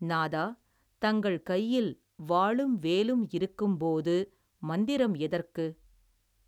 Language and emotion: Tamil, neutral